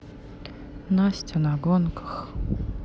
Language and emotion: Russian, sad